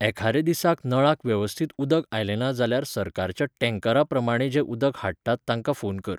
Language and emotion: Goan Konkani, neutral